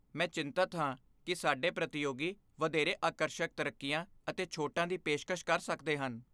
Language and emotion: Punjabi, fearful